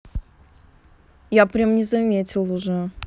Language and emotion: Russian, neutral